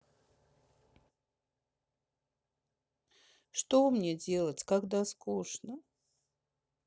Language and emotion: Russian, sad